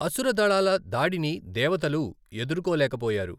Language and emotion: Telugu, neutral